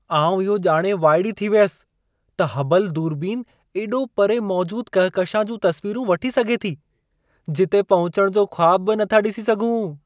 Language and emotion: Sindhi, surprised